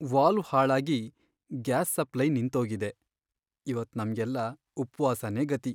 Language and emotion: Kannada, sad